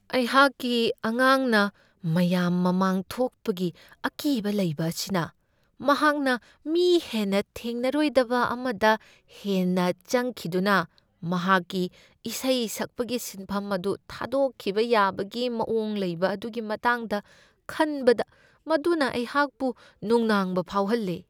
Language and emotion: Manipuri, fearful